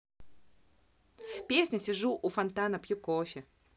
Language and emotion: Russian, positive